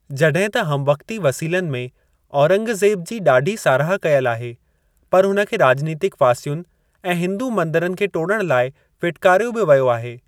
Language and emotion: Sindhi, neutral